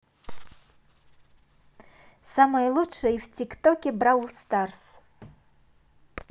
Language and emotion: Russian, positive